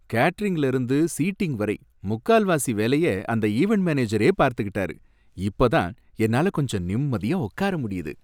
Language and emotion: Tamil, happy